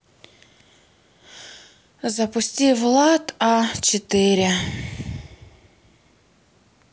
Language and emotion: Russian, sad